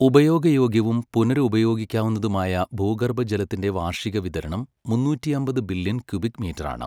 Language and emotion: Malayalam, neutral